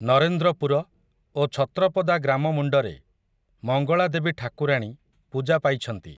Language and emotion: Odia, neutral